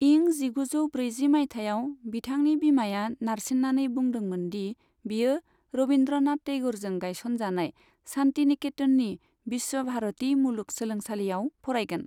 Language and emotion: Bodo, neutral